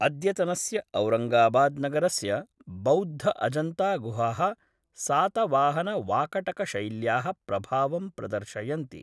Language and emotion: Sanskrit, neutral